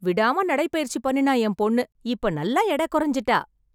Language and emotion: Tamil, happy